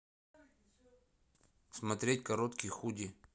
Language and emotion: Russian, neutral